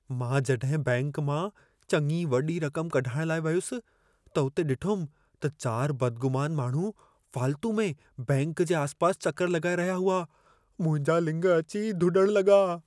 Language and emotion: Sindhi, fearful